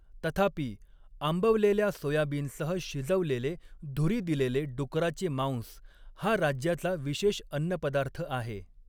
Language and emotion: Marathi, neutral